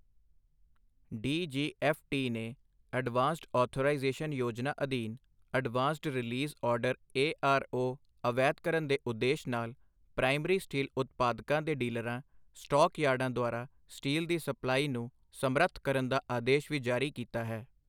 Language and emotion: Punjabi, neutral